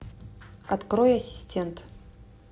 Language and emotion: Russian, neutral